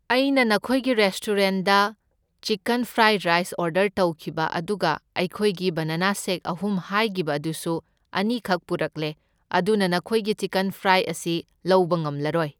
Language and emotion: Manipuri, neutral